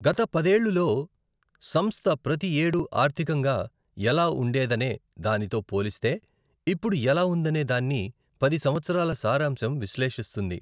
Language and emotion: Telugu, neutral